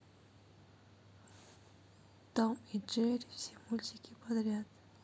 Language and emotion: Russian, sad